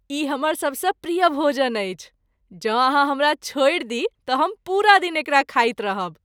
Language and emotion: Maithili, happy